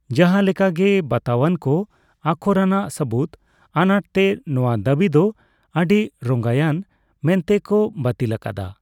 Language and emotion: Santali, neutral